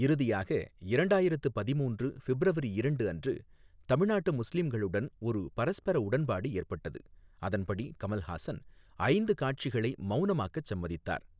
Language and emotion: Tamil, neutral